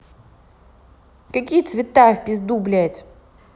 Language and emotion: Russian, angry